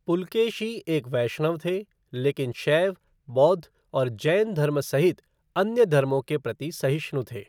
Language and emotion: Hindi, neutral